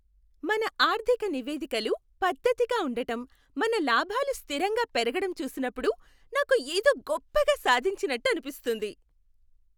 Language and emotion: Telugu, happy